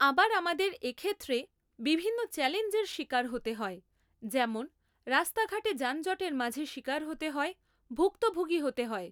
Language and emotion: Bengali, neutral